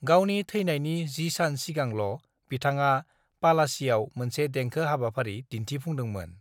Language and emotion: Bodo, neutral